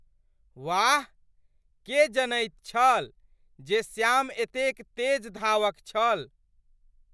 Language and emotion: Maithili, surprised